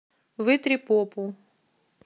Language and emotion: Russian, neutral